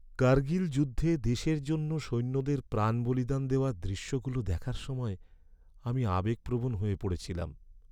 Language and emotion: Bengali, sad